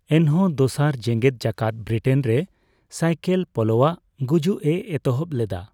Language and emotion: Santali, neutral